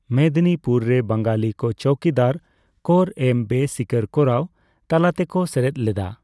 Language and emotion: Santali, neutral